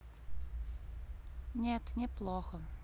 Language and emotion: Russian, sad